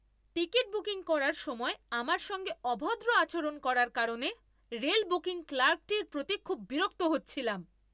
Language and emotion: Bengali, angry